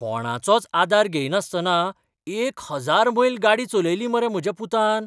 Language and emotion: Goan Konkani, surprised